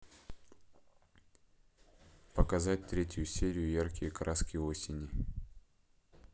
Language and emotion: Russian, neutral